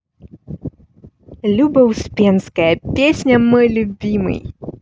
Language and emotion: Russian, positive